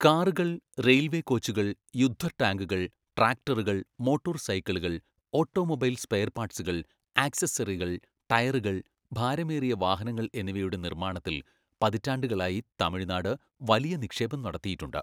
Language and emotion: Malayalam, neutral